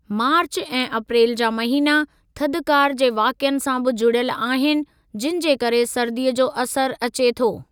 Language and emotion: Sindhi, neutral